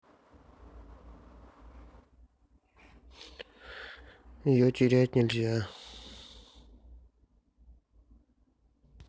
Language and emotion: Russian, sad